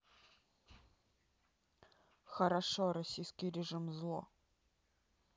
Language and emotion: Russian, neutral